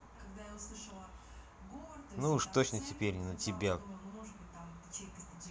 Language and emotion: Russian, angry